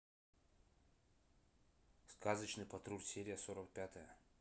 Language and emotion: Russian, neutral